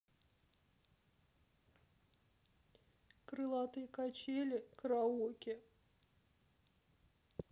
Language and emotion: Russian, sad